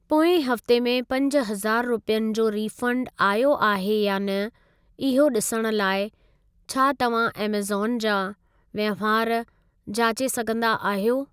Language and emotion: Sindhi, neutral